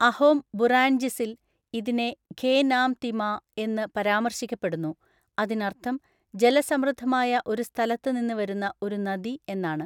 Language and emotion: Malayalam, neutral